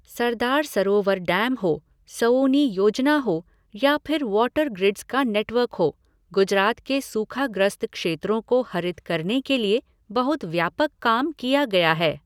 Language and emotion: Hindi, neutral